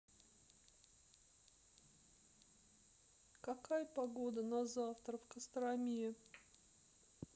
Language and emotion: Russian, sad